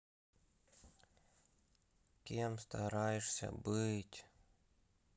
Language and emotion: Russian, sad